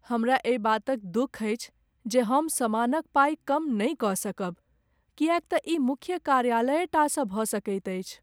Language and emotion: Maithili, sad